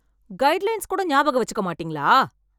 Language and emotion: Tamil, angry